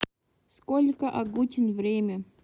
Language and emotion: Russian, neutral